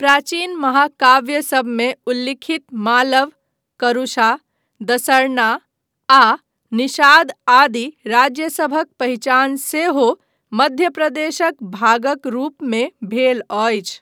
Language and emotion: Maithili, neutral